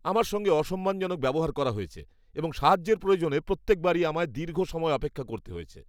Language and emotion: Bengali, disgusted